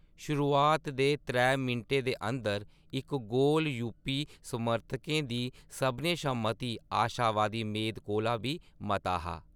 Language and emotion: Dogri, neutral